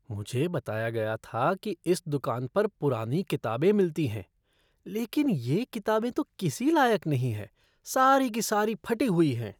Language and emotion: Hindi, disgusted